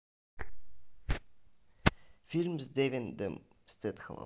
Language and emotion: Russian, neutral